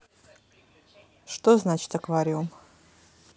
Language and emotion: Russian, neutral